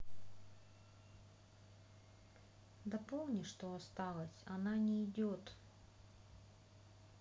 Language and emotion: Russian, sad